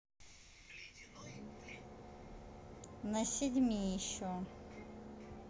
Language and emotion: Russian, neutral